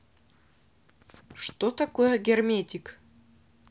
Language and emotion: Russian, neutral